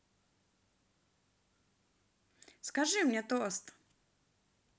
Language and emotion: Russian, positive